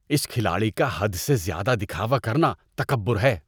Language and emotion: Urdu, disgusted